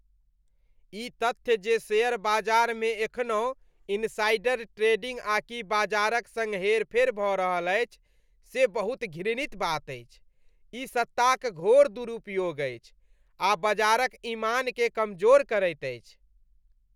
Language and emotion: Maithili, disgusted